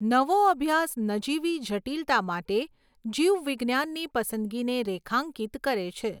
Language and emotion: Gujarati, neutral